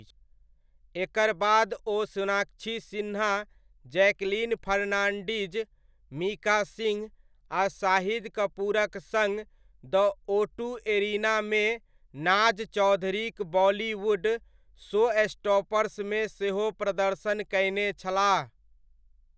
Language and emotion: Maithili, neutral